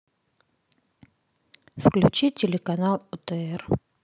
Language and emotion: Russian, neutral